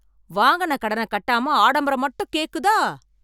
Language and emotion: Tamil, angry